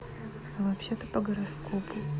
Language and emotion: Russian, neutral